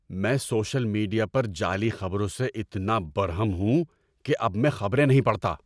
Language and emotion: Urdu, angry